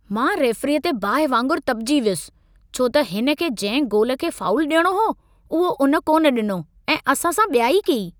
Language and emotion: Sindhi, angry